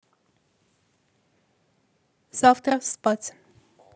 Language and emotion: Russian, neutral